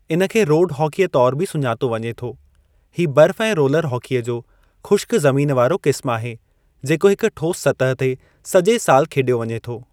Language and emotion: Sindhi, neutral